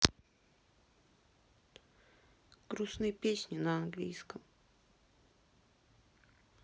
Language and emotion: Russian, sad